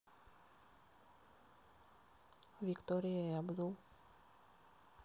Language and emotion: Russian, neutral